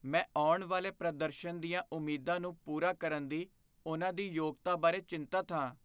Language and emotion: Punjabi, fearful